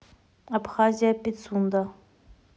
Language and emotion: Russian, neutral